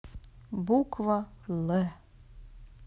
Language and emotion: Russian, neutral